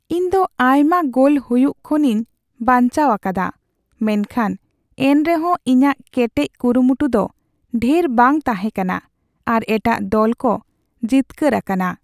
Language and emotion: Santali, sad